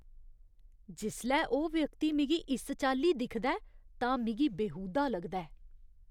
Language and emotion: Dogri, disgusted